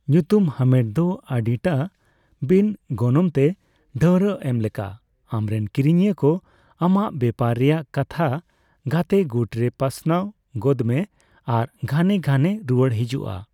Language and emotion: Santali, neutral